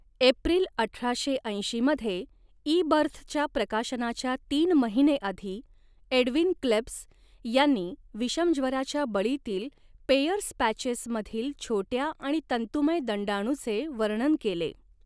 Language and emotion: Marathi, neutral